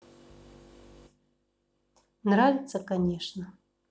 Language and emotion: Russian, neutral